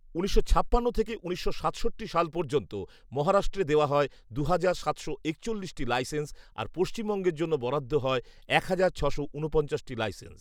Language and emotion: Bengali, neutral